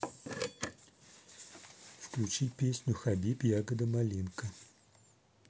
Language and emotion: Russian, neutral